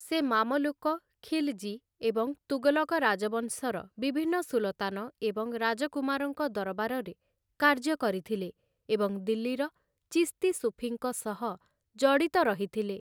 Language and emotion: Odia, neutral